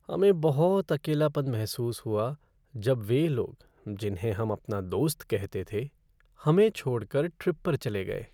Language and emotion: Hindi, sad